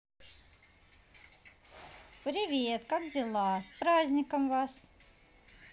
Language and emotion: Russian, neutral